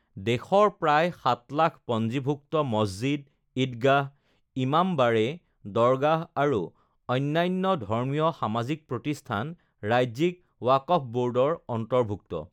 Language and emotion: Assamese, neutral